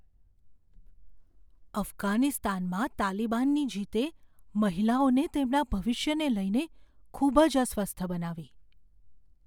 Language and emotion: Gujarati, fearful